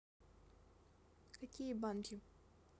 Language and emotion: Russian, neutral